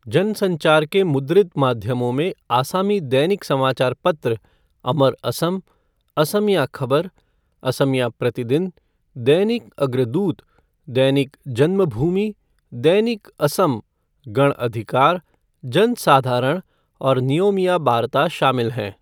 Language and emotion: Hindi, neutral